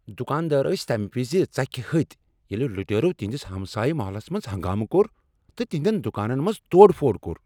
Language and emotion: Kashmiri, angry